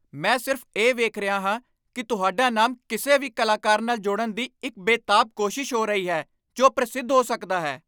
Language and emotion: Punjabi, angry